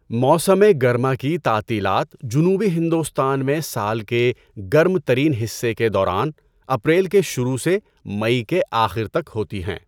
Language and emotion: Urdu, neutral